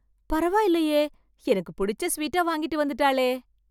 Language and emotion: Tamil, surprised